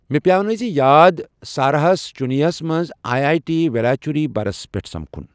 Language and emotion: Kashmiri, neutral